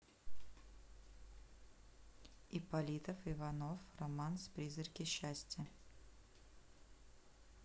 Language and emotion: Russian, neutral